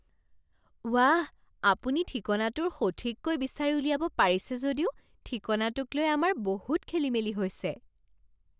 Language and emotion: Assamese, surprised